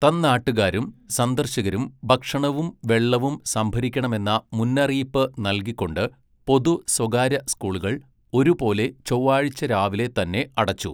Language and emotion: Malayalam, neutral